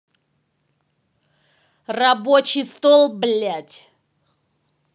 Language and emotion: Russian, angry